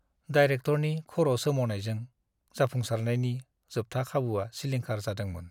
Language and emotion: Bodo, sad